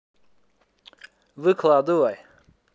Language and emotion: Russian, neutral